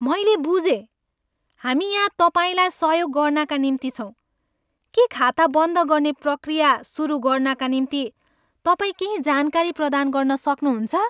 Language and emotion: Nepali, happy